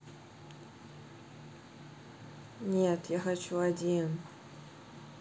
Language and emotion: Russian, neutral